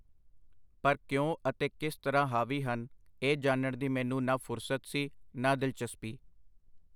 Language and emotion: Punjabi, neutral